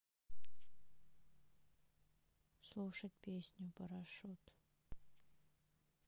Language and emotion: Russian, sad